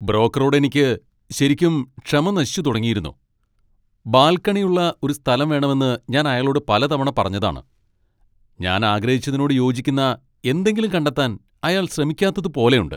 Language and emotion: Malayalam, angry